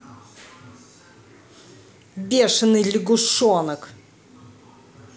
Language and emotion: Russian, angry